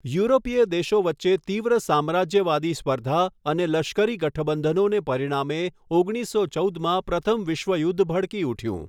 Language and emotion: Gujarati, neutral